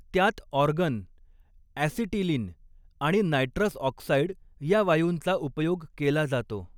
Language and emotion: Marathi, neutral